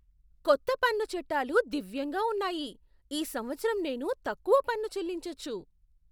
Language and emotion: Telugu, surprised